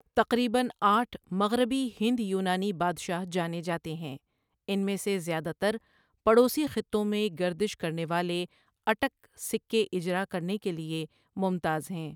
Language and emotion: Urdu, neutral